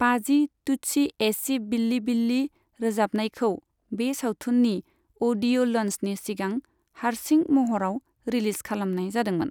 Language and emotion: Bodo, neutral